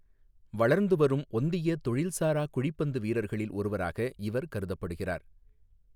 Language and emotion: Tamil, neutral